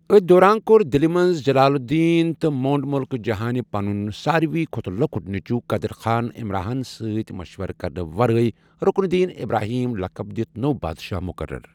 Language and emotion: Kashmiri, neutral